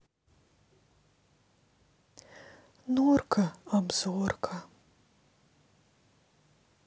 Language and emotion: Russian, sad